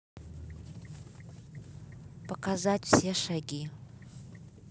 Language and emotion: Russian, neutral